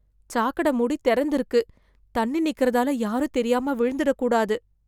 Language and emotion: Tamil, fearful